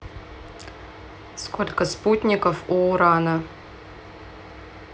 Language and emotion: Russian, neutral